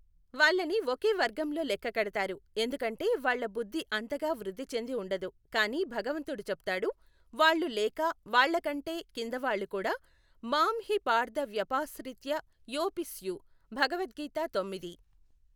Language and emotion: Telugu, neutral